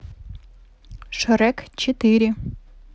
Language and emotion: Russian, neutral